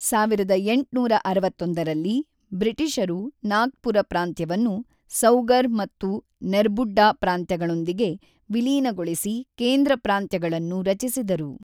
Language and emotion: Kannada, neutral